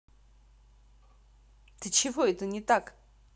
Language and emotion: Russian, angry